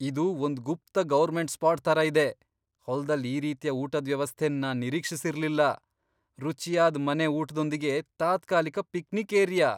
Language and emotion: Kannada, surprised